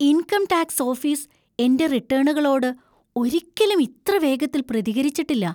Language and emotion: Malayalam, surprised